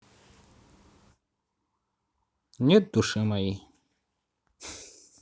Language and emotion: Russian, neutral